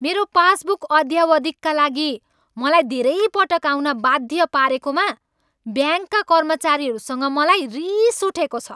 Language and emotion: Nepali, angry